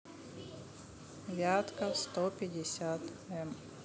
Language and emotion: Russian, neutral